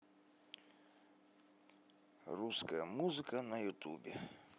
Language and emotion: Russian, neutral